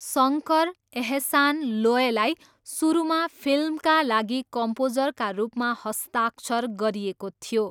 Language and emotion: Nepali, neutral